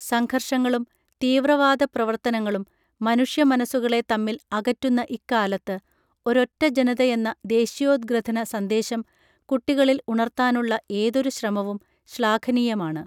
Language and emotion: Malayalam, neutral